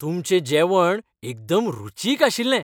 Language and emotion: Goan Konkani, happy